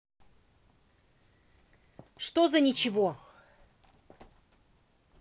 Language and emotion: Russian, angry